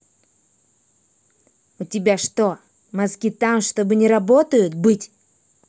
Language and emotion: Russian, angry